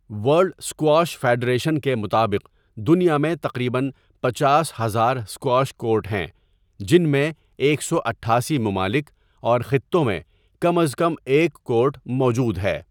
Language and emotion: Urdu, neutral